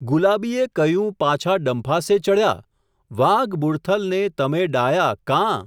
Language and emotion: Gujarati, neutral